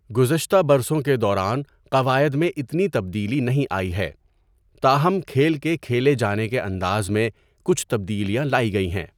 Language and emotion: Urdu, neutral